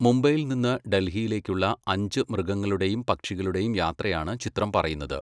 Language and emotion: Malayalam, neutral